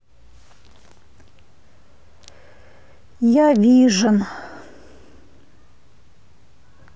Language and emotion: Russian, sad